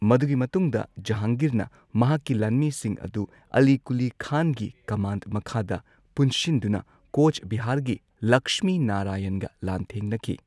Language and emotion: Manipuri, neutral